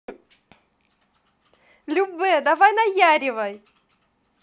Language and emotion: Russian, positive